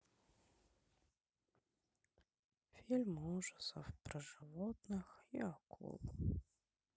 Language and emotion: Russian, sad